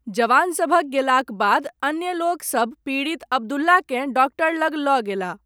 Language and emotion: Maithili, neutral